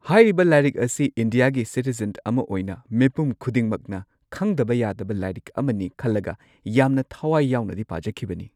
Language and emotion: Manipuri, neutral